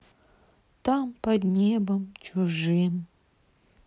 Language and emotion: Russian, sad